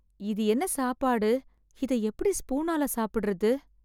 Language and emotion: Tamil, sad